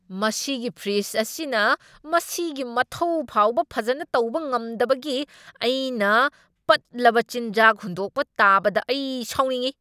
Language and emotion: Manipuri, angry